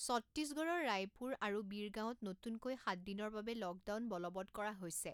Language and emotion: Assamese, neutral